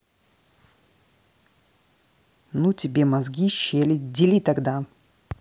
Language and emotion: Russian, angry